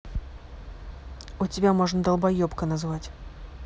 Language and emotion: Russian, angry